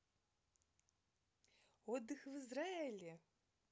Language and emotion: Russian, positive